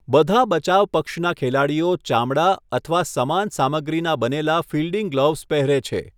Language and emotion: Gujarati, neutral